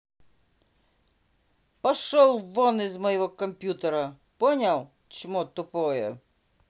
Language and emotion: Russian, angry